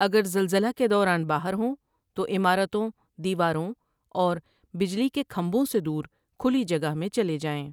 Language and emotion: Urdu, neutral